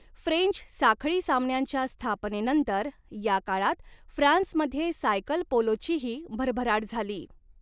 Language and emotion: Marathi, neutral